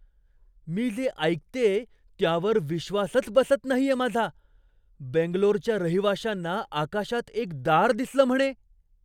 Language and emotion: Marathi, surprised